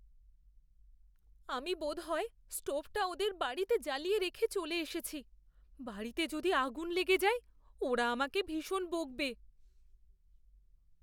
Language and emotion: Bengali, fearful